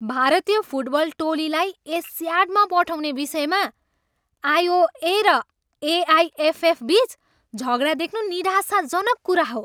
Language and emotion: Nepali, angry